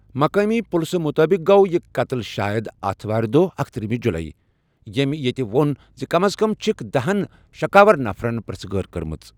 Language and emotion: Kashmiri, neutral